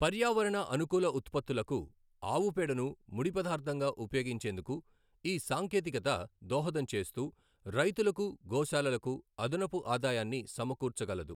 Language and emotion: Telugu, neutral